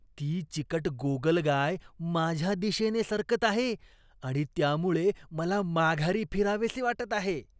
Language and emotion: Marathi, disgusted